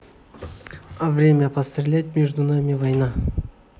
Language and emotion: Russian, neutral